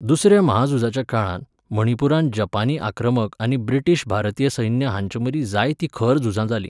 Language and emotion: Goan Konkani, neutral